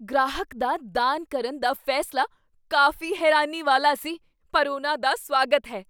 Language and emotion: Punjabi, surprised